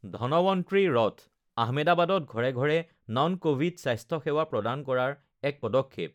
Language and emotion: Assamese, neutral